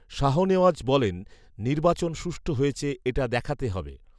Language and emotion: Bengali, neutral